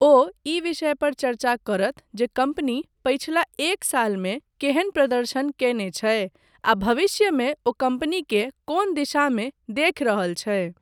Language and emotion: Maithili, neutral